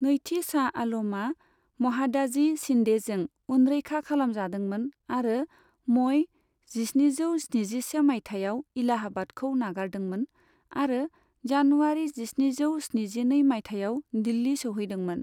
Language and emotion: Bodo, neutral